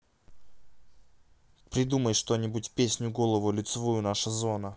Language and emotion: Russian, neutral